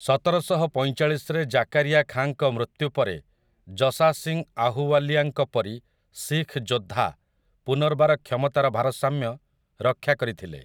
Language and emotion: Odia, neutral